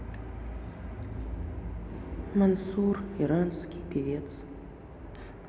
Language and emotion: Russian, sad